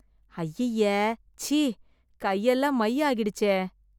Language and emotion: Tamil, disgusted